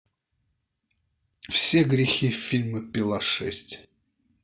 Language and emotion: Russian, neutral